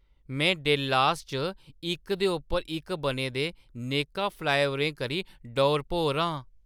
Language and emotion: Dogri, surprised